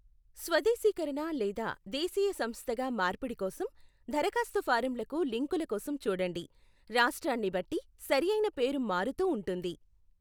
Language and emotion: Telugu, neutral